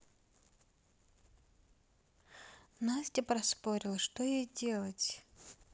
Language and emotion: Russian, neutral